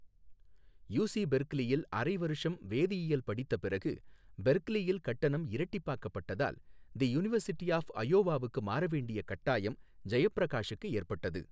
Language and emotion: Tamil, neutral